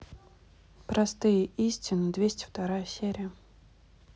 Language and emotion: Russian, neutral